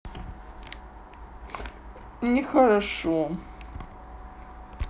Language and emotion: Russian, sad